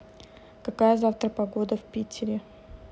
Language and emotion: Russian, neutral